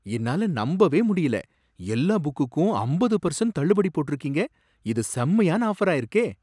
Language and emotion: Tamil, surprised